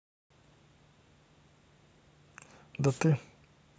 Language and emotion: Russian, neutral